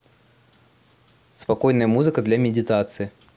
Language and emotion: Russian, neutral